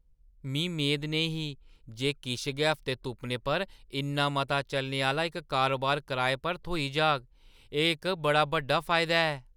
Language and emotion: Dogri, surprised